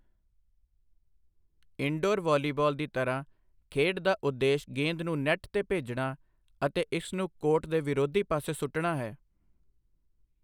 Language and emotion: Punjabi, neutral